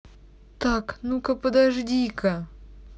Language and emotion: Russian, angry